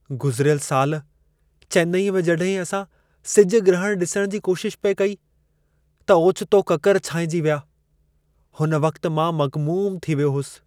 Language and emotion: Sindhi, sad